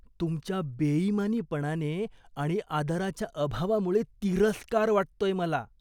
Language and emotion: Marathi, disgusted